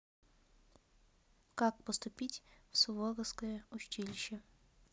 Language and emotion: Russian, neutral